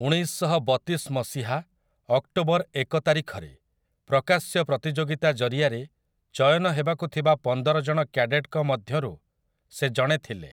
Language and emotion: Odia, neutral